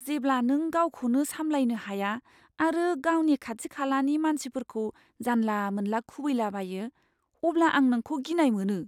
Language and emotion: Bodo, fearful